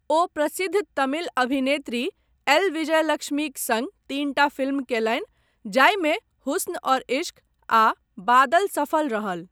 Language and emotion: Maithili, neutral